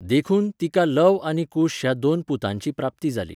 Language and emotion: Goan Konkani, neutral